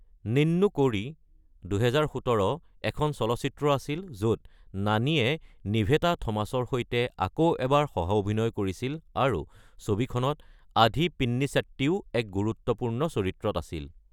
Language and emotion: Assamese, neutral